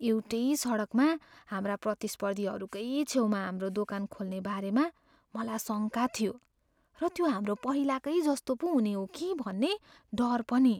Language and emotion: Nepali, fearful